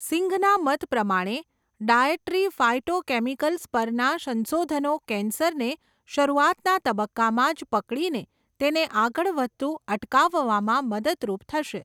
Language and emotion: Gujarati, neutral